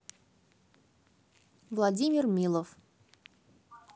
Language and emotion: Russian, neutral